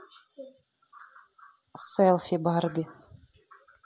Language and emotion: Russian, neutral